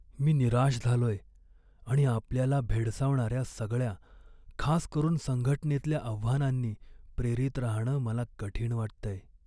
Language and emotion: Marathi, sad